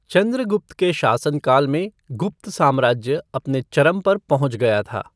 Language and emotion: Hindi, neutral